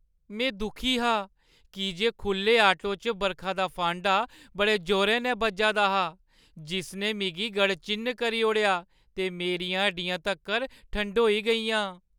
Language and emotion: Dogri, sad